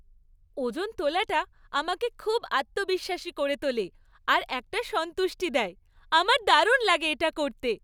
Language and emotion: Bengali, happy